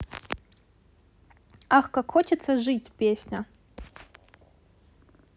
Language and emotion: Russian, positive